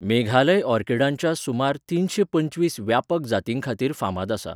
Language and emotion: Goan Konkani, neutral